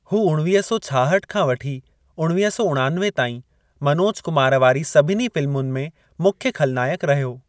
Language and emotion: Sindhi, neutral